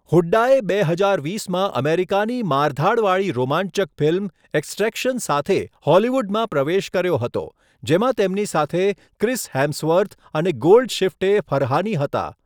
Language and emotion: Gujarati, neutral